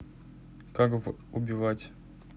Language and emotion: Russian, neutral